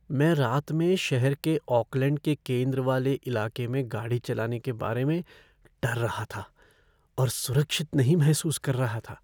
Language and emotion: Hindi, fearful